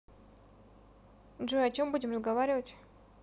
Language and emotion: Russian, neutral